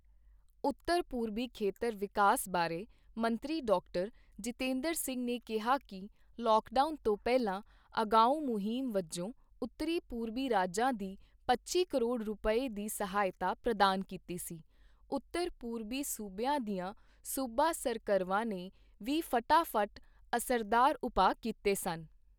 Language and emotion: Punjabi, neutral